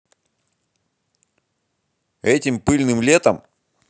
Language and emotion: Russian, angry